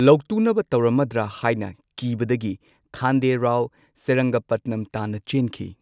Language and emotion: Manipuri, neutral